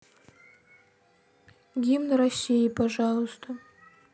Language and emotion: Russian, sad